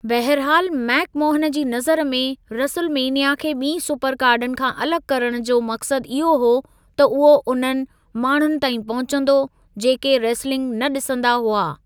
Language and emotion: Sindhi, neutral